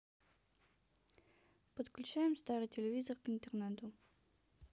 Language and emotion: Russian, neutral